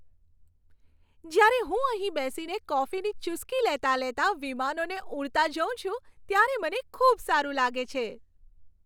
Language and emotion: Gujarati, happy